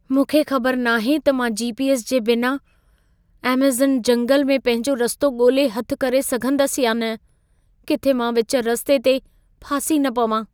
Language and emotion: Sindhi, fearful